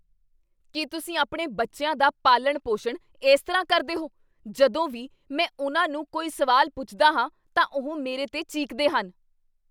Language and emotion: Punjabi, angry